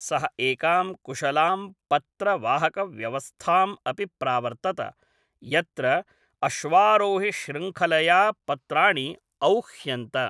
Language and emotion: Sanskrit, neutral